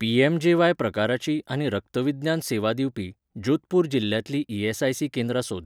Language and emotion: Goan Konkani, neutral